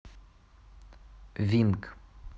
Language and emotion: Russian, neutral